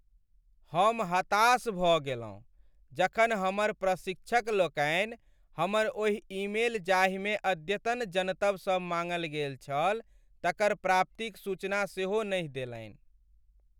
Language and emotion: Maithili, sad